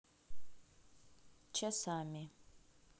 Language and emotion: Russian, neutral